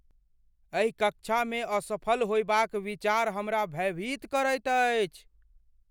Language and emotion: Maithili, fearful